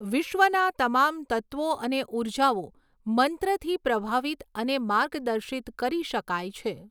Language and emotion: Gujarati, neutral